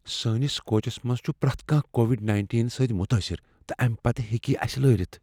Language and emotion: Kashmiri, fearful